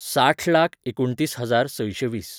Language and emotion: Goan Konkani, neutral